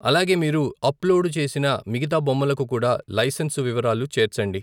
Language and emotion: Telugu, neutral